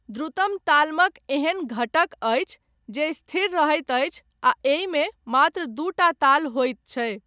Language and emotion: Maithili, neutral